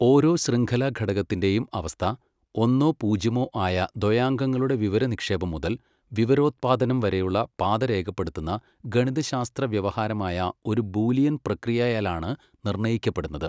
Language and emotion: Malayalam, neutral